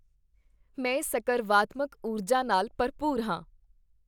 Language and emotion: Punjabi, happy